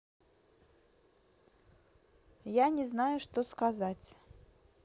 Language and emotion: Russian, neutral